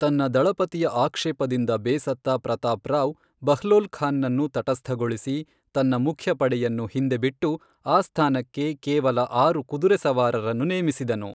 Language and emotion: Kannada, neutral